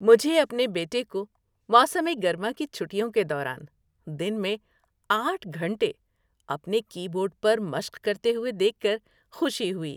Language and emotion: Urdu, happy